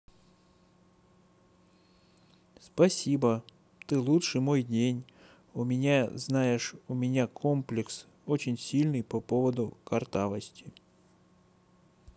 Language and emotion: Russian, neutral